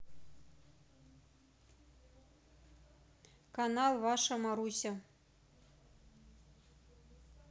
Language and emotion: Russian, neutral